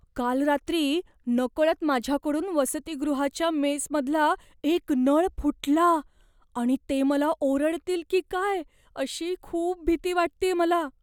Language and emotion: Marathi, fearful